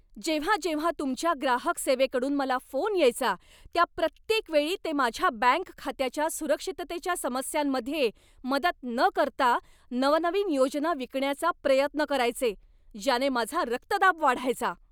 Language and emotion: Marathi, angry